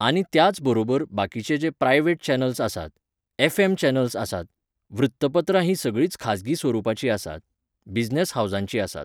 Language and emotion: Goan Konkani, neutral